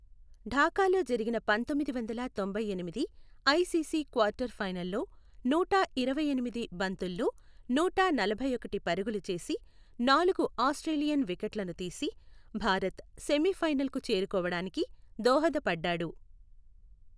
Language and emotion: Telugu, neutral